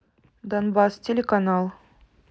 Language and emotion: Russian, neutral